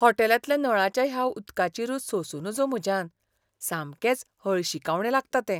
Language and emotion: Goan Konkani, disgusted